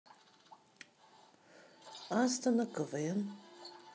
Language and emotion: Russian, neutral